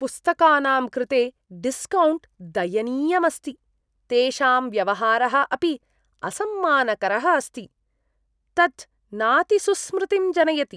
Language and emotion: Sanskrit, disgusted